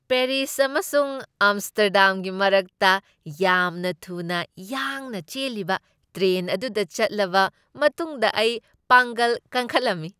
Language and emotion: Manipuri, happy